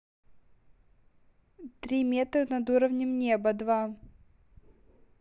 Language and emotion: Russian, neutral